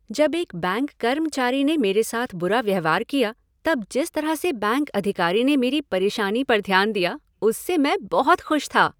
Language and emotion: Hindi, happy